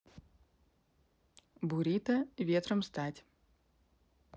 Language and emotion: Russian, neutral